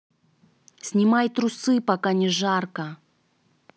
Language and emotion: Russian, neutral